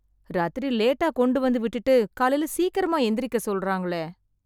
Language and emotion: Tamil, sad